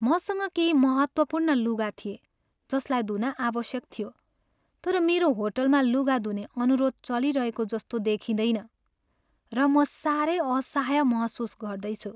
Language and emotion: Nepali, sad